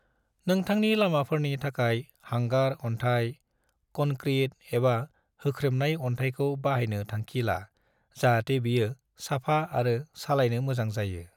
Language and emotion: Bodo, neutral